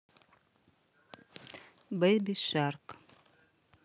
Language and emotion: Russian, neutral